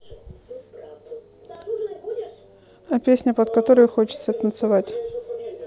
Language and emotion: Russian, neutral